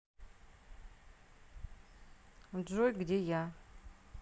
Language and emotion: Russian, neutral